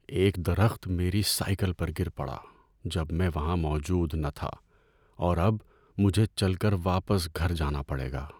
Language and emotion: Urdu, sad